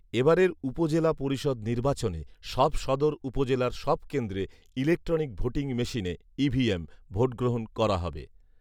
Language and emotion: Bengali, neutral